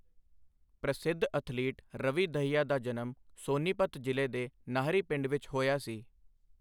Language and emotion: Punjabi, neutral